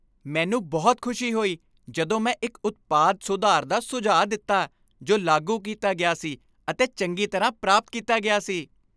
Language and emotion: Punjabi, happy